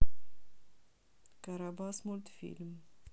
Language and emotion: Russian, neutral